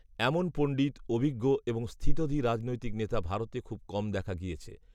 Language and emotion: Bengali, neutral